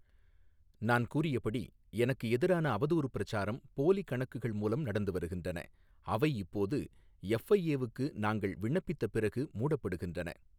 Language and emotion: Tamil, neutral